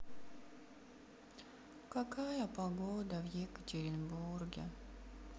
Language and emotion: Russian, sad